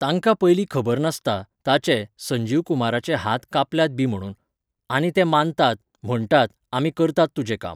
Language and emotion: Goan Konkani, neutral